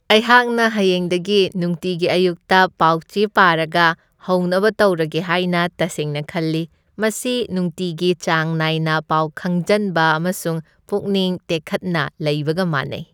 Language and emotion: Manipuri, happy